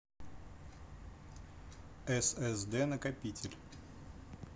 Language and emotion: Russian, neutral